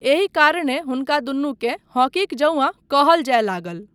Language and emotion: Maithili, neutral